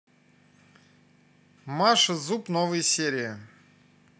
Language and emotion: Russian, neutral